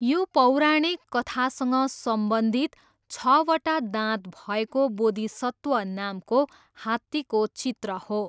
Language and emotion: Nepali, neutral